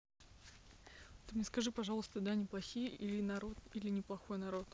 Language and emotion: Russian, neutral